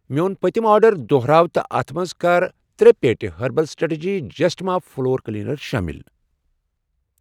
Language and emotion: Kashmiri, neutral